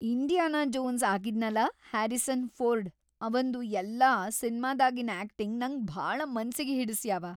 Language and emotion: Kannada, happy